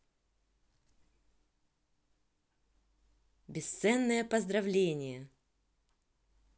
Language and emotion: Russian, positive